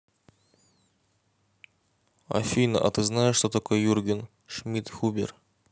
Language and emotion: Russian, neutral